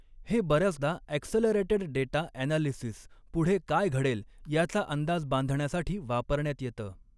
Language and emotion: Marathi, neutral